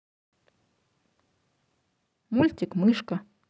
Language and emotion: Russian, neutral